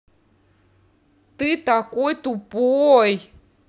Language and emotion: Russian, angry